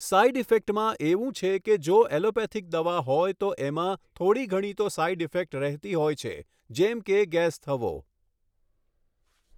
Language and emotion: Gujarati, neutral